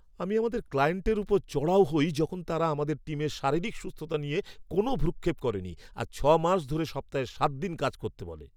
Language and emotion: Bengali, angry